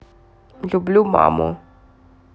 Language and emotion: Russian, neutral